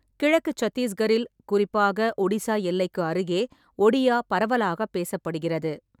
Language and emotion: Tamil, neutral